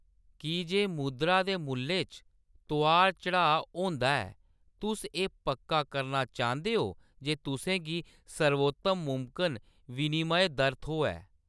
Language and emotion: Dogri, neutral